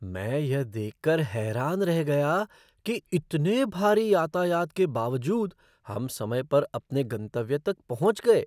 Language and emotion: Hindi, surprised